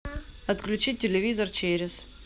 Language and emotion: Russian, neutral